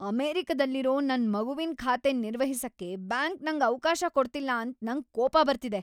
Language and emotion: Kannada, angry